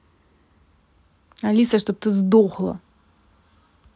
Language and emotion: Russian, angry